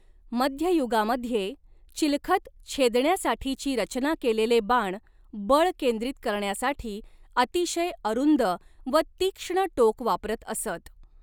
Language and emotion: Marathi, neutral